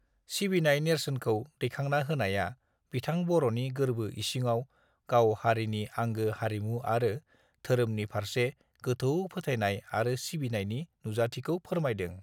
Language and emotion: Bodo, neutral